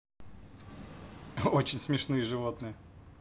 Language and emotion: Russian, positive